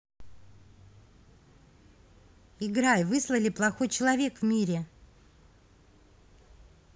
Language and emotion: Russian, neutral